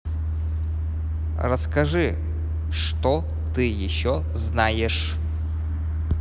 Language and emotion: Russian, positive